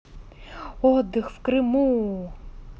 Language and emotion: Russian, positive